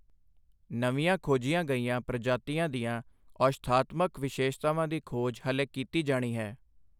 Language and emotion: Punjabi, neutral